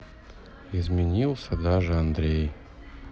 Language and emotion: Russian, sad